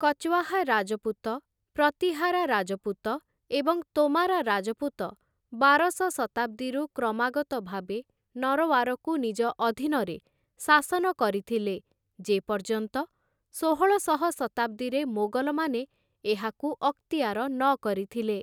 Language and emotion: Odia, neutral